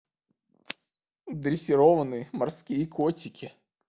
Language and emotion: Russian, sad